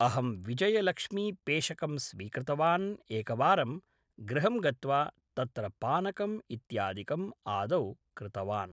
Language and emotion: Sanskrit, neutral